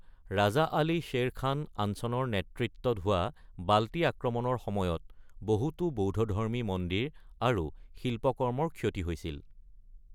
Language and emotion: Assamese, neutral